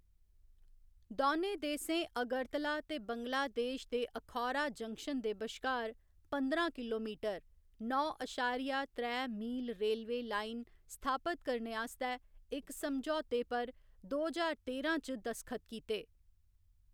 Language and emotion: Dogri, neutral